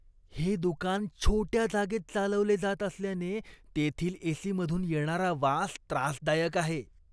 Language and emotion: Marathi, disgusted